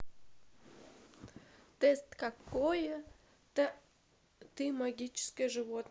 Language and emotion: Russian, neutral